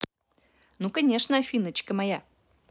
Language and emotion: Russian, positive